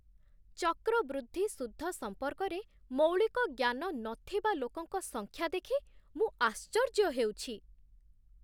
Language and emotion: Odia, surprised